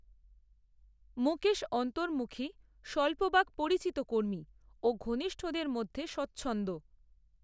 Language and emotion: Bengali, neutral